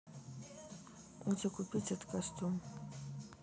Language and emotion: Russian, neutral